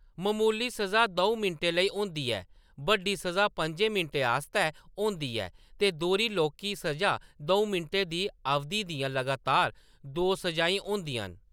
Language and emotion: Dogri, neutral